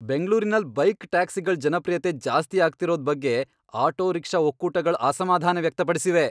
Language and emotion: Kannada, angry